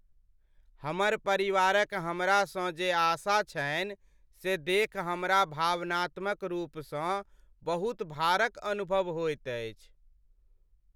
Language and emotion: Maithili, sad